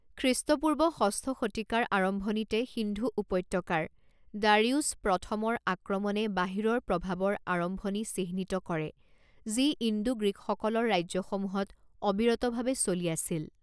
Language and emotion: Assamese, neutral